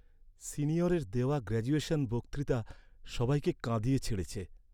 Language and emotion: Bengali, sad